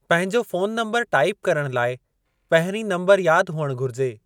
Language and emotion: Sindhi, neutral